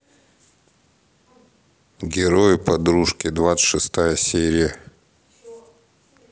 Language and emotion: Russian, neutral